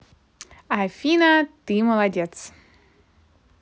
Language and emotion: Russian, positive